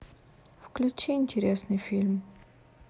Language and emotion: Russian, sad